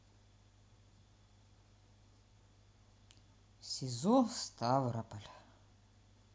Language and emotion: Russian, sad